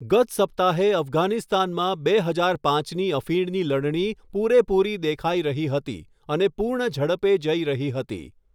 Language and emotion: Gujarati, neutral